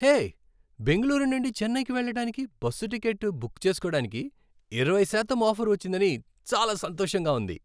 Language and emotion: Telugu, happy